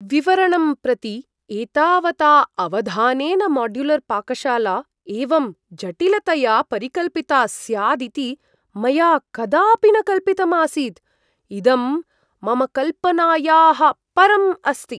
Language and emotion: Sanskrit, surprised